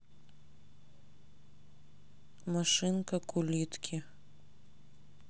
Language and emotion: Russian, neutral